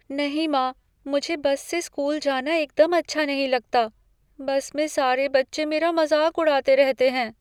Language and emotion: Hindi, fearful